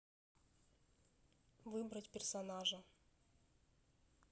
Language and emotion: Russian, neutral